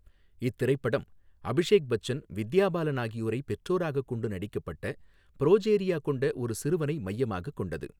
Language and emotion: Tamil, neutral